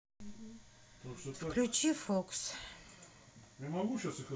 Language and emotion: Russian, sad